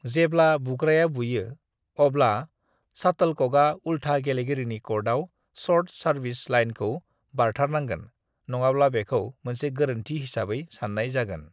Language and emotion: Bodo, neutral